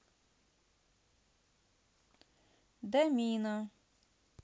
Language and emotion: Russian, neutral